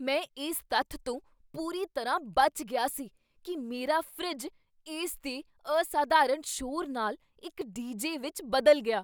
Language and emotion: Punjabi, surprised